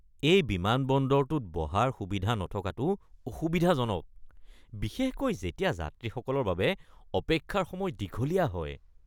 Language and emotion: Assamese, disgusted